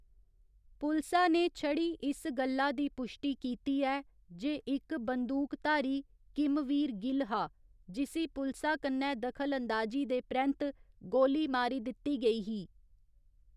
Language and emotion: Dogri, neutral